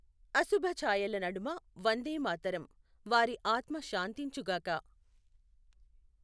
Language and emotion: Telugu, neutral